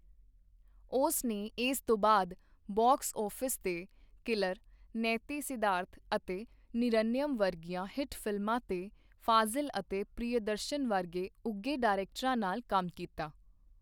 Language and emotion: Punjabi, neutral